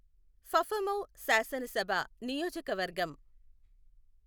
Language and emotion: Telugu, neutral